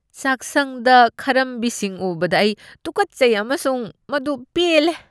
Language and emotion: Manipuri, disgusted